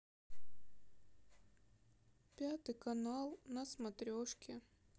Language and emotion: Russian, sad